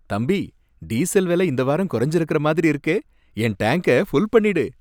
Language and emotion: Tamil, happy